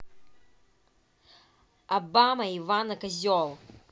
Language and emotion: Russian, angry